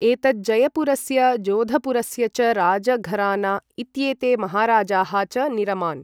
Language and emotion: Sanskrit, neutral